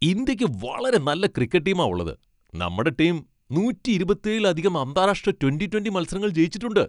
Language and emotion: Malayalam, happy